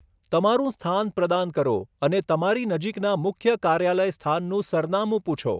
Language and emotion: Gujarati, neutral